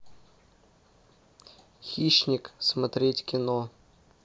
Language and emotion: Russian, neutral